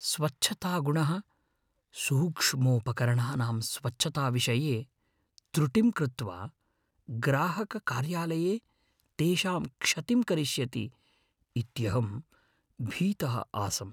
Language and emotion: Sanskrit, fearful